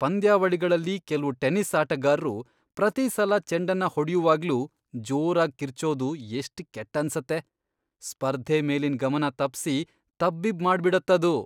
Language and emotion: Kannada, disgusted